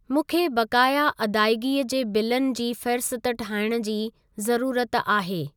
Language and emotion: Sindhi, neutral